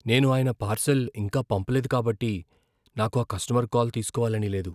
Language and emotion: Telugu, fearful